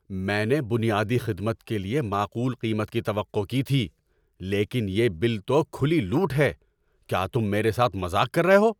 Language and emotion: Urdu, angry